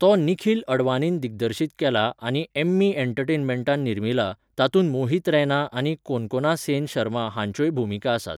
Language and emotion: Goan Konkani, neutral